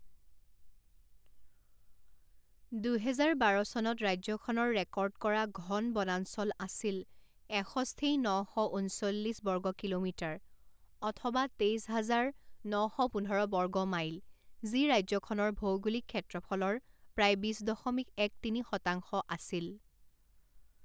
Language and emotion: Assamese, neutral